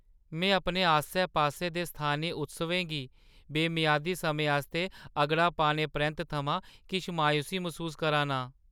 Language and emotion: Dogri, sad